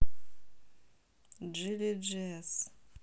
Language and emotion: Russian, neutral